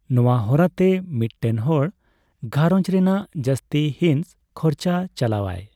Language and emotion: Santali, neutral